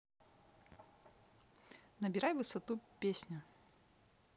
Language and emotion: Russian, neutral